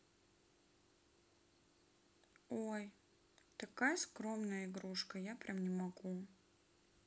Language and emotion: Russian, neutral